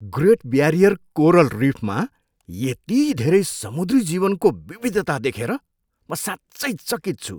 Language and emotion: Nepali, surprised